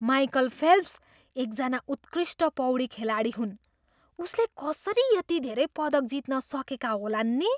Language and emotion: Nepali, surprised